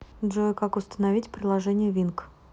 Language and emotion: Russian, neutral